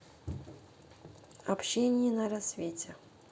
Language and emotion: Russian, neutral